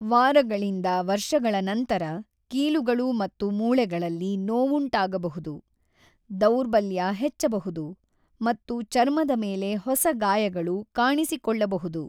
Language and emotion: Kannada, neutral